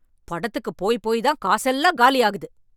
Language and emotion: Tamil, angry